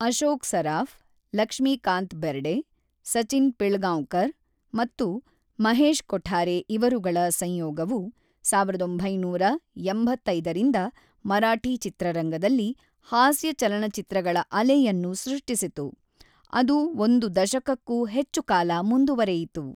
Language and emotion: Kannada, neutral